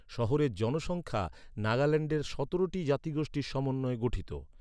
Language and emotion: Bengali, neutral